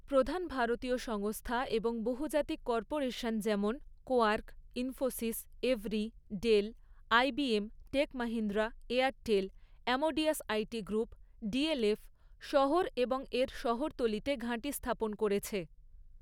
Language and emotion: Bengali, neutral